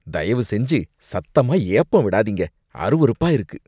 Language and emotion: Tamil, disgusted